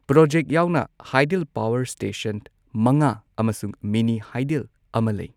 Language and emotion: Manipuri, neutral